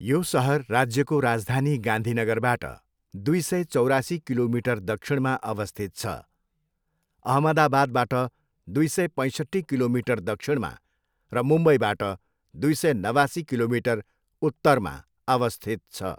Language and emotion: Nepali, neutral